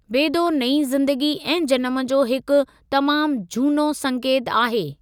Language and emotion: Sindhi, neutral